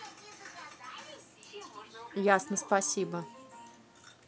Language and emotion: Russian, angry